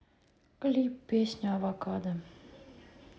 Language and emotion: Russian, sad